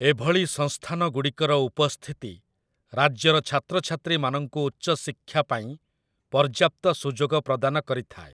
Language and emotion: Odia, neutral